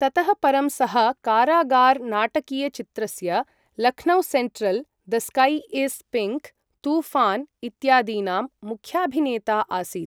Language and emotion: Sanskrit, neutral